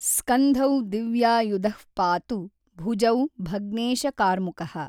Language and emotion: Kannada, neutral